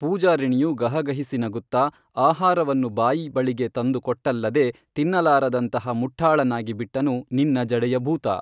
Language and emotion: Kannada, neutral